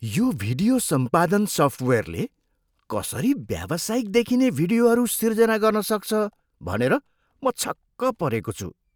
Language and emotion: Nepali, surprised